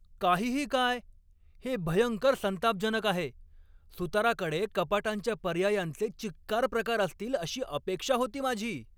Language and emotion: Marathi, angry